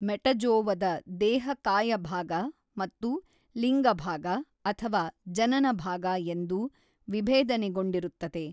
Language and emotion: Kannada, neutral